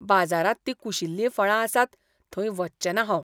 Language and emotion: Goan Konkani, disgusted